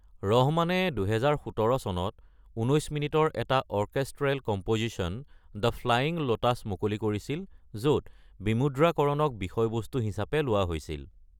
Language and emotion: Assamese, neutral